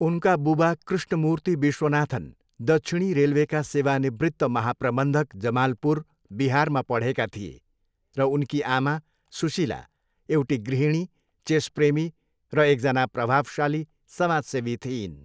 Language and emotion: Nepali, neutral